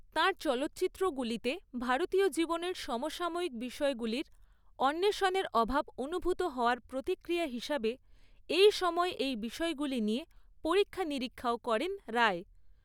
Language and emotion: Bengali, neutral